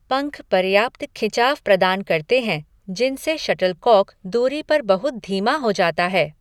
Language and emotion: Hindi, neutral